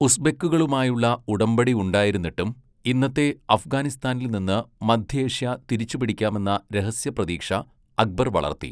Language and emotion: Malayalam, neutral